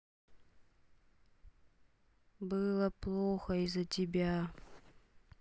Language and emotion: Russian, sad